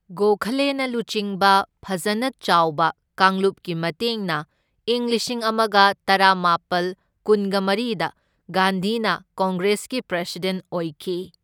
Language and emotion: Manipuri, neutral